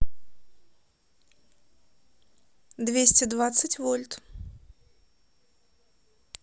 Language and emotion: Russian, neutral